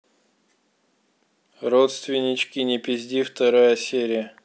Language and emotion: Russian, neutral